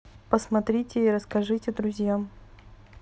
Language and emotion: Russian, neutral